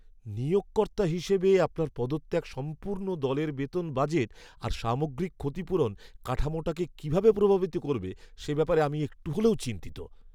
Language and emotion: Bengali, fearful